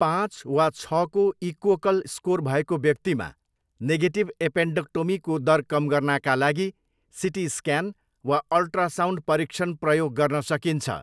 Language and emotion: Nepali, neutral